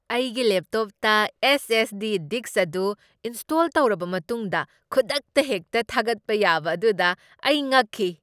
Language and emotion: Manipuri, surprised